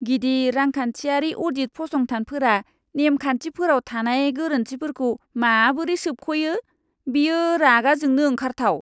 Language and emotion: Bodo, disgusted